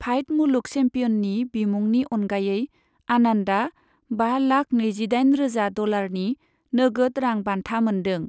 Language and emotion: Bodo, neutral